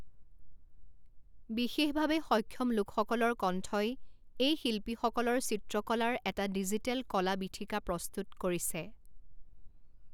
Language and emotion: Assamese, neutral